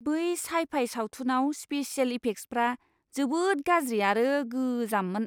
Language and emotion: Bodo, disgusted